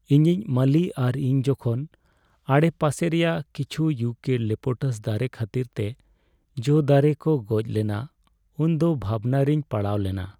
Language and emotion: Santali, sad